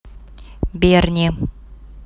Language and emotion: Russian, neutral